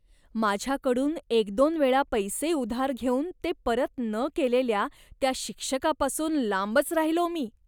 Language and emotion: Marathi, disgusted